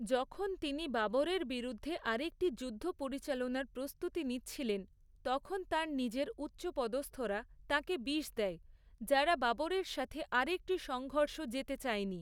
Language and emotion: Bengali, neutral